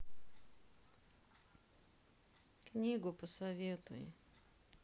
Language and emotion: Russian, sad